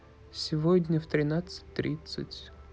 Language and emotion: Russian, sad